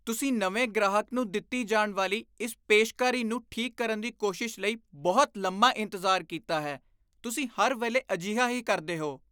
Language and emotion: Punjabi, disgusted